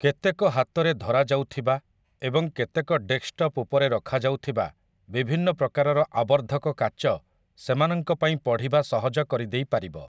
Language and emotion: Odia, neutral